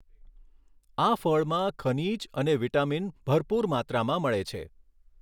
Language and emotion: Gujarati, neutral